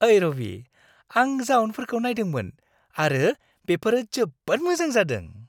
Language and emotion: Bodo, happy